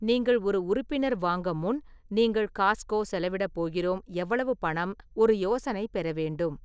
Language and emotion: Tamil, neutral